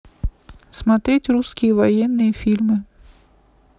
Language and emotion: Russian, neutral